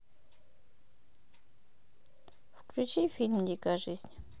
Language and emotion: Russian, neutral